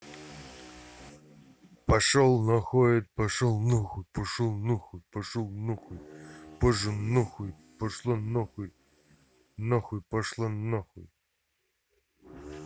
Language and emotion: Russian, angry